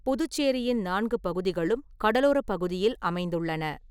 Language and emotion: Tamil, neutral